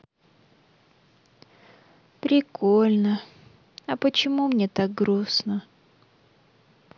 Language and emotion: Russian, sad